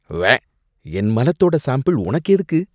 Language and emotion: Tamil, disgusted